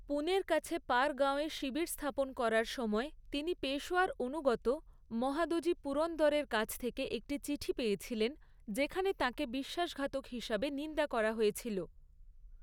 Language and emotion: Bengali, neutral